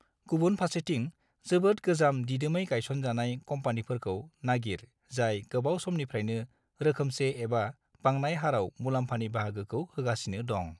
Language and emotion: Bodo, neutral